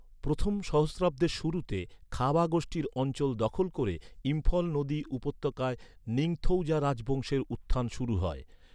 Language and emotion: Bengali, neutral